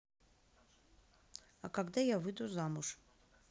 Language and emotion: Russian, neutral